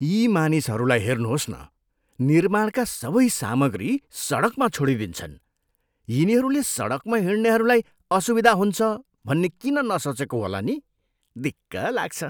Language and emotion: Nepali, disgusted